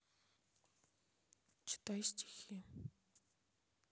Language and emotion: Russian, sad